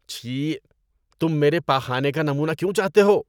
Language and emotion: Urdu, disgusted